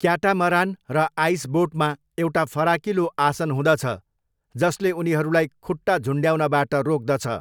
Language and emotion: Nepali, neutral